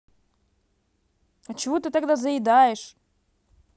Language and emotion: Russian, angry